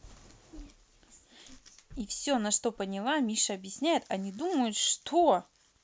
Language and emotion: Russian, neutral